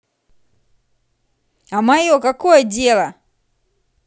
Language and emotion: Russian, angry